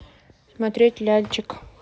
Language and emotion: Russian, neutral